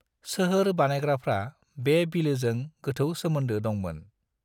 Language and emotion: Bodo, neutral